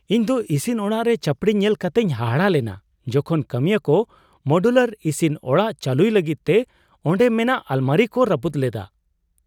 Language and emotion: Santali, surprised